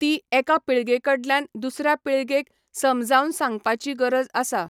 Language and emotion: Goan Konkani, neutral